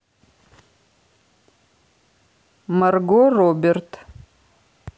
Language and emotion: Russian, neutral